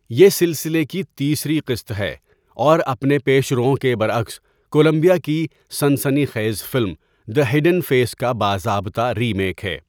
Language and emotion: Urdu, neutral